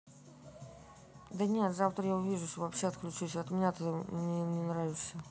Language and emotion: Russian, neutral